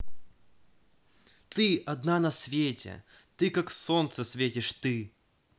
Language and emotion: Russian, positive